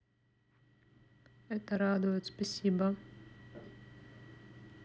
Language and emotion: Russian, neutral